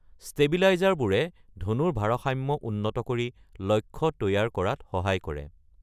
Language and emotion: Assamese, neutral